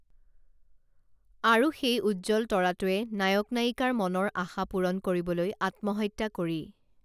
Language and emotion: Assamese, neutral